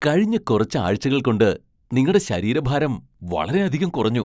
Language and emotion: Malayalam, surprised